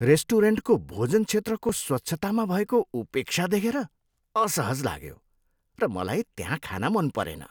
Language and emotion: Nepali, disgusted